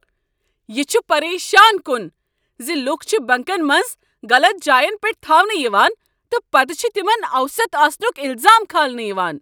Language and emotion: Kashmiri, angry